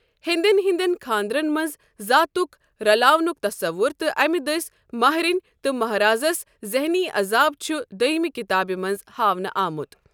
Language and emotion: Kashmiri, neutral